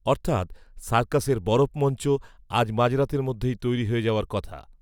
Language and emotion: Bengali, neutral